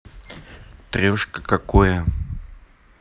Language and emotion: Russian, neutral